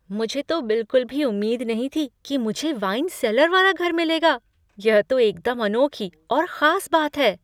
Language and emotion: Hindi, surprised